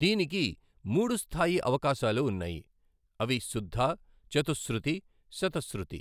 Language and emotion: Telugu, neutral